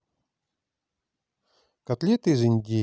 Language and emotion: Russian, neutral